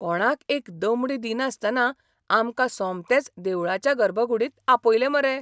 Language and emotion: Goan Konkani, surprised